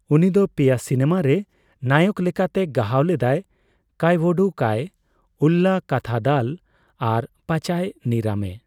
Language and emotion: Santali, neutral